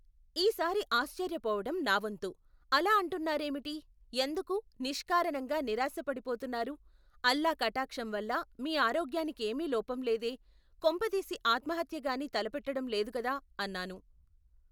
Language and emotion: Telugu, neutral